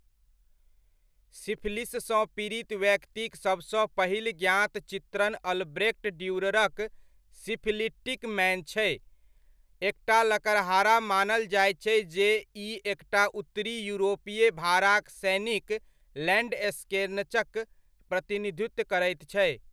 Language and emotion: Maithili, neutral